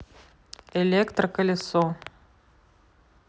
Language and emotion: Russian, neutral